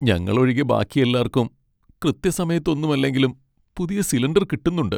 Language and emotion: Malayalam, sad